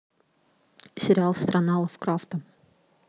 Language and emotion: Russian, neutral